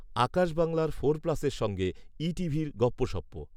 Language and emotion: Bengali, neutral